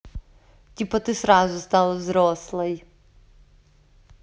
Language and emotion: Russian, positive